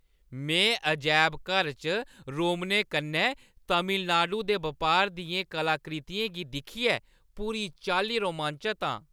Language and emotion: Dogri, happy